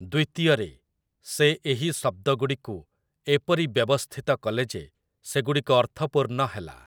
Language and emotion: Odia, neutral